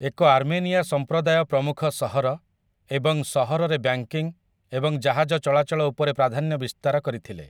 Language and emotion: Odia, neutral